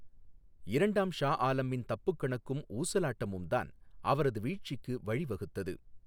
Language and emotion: Tamil, neutral